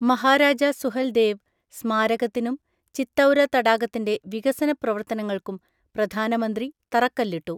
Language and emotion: Malayalam, neutral